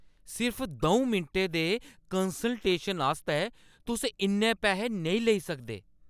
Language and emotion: Dogri, angry